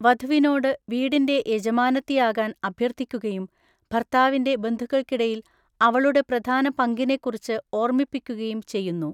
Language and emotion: Malayalam, neutral